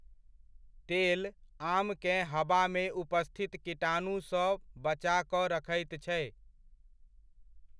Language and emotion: Maithili, neutral